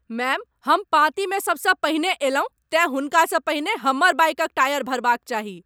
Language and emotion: Maithili, angry